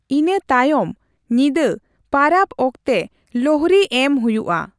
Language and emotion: Santali, neutral